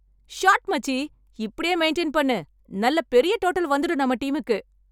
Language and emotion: Tamil, happy